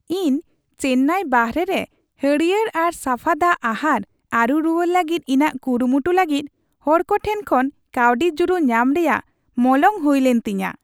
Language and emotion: Santali, happy